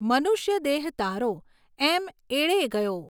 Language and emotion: Gujarati, neutral